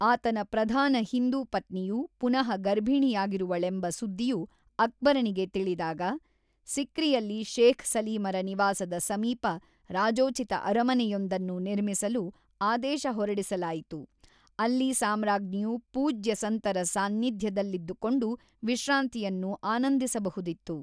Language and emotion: Kannada, neutral